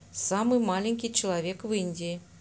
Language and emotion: Russian, neutral